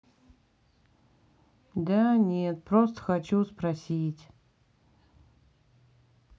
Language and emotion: Russian, sad